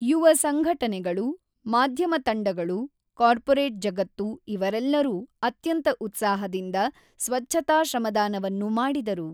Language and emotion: Kannada, neutral